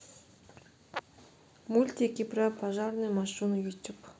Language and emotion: Russian, neutral